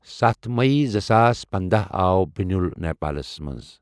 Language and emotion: Kashmiri, neutral